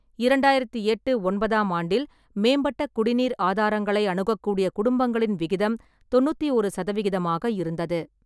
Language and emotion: Tamil, neutral